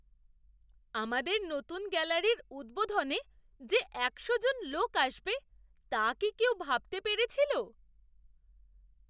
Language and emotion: Bengali, surprised